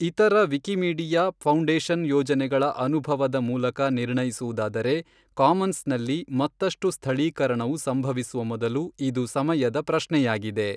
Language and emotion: Kannada, neutral